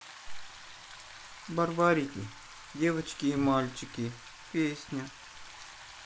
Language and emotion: Russian, sad